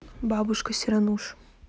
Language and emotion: Russian, neutral